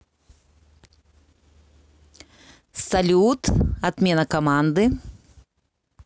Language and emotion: Russian, positive